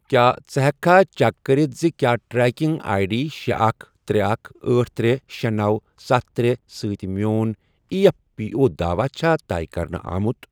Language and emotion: Kashmiri, neutral